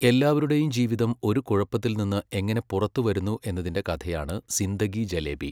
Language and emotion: Malayalam, neutral